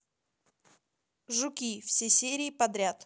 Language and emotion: Russian, neutral